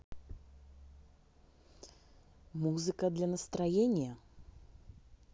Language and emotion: Russian, neutral